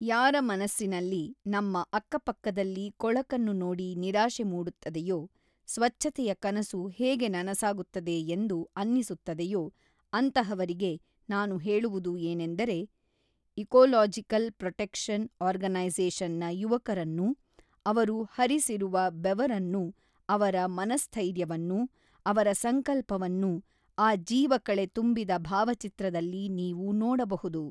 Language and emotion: Kannada, neutral